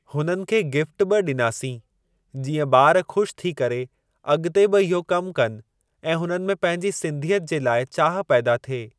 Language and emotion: Sindhi, neutral